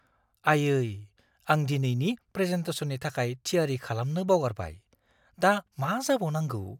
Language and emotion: Bodo, fearful